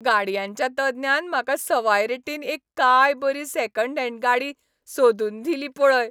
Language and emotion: Goan Konkani, happy